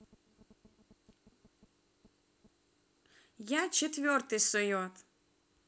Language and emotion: Russian, neutral